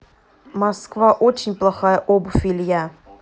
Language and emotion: Russian, neutral